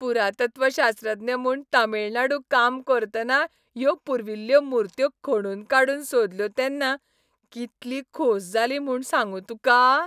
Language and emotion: Goan Konkani, happy